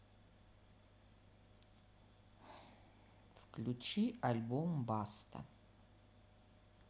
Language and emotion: Russian, neutral